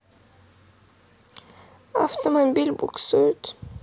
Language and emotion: Russian, sad